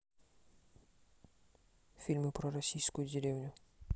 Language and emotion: Russian, neutral